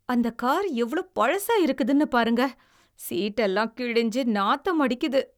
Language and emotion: Tamil, disgusted